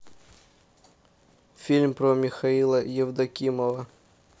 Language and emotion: Russian, neutral